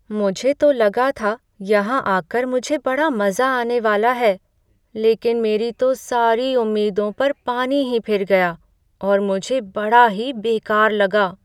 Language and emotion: Hindi, sad